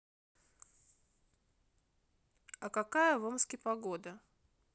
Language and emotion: Russian, neutral